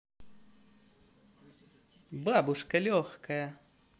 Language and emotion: Russian, positive